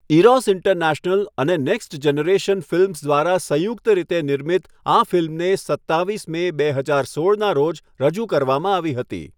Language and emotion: Gujarati, neutral